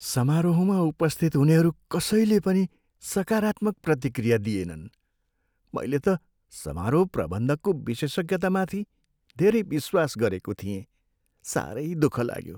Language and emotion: Nepali, sad